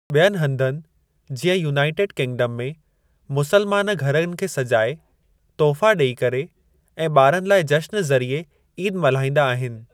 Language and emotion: Sindhi, neutral